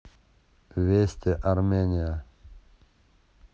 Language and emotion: Russian, neutral